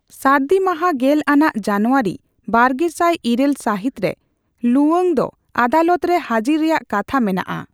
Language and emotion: Santali, neutral